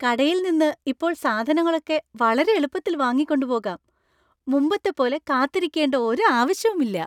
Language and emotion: Malayalam, happy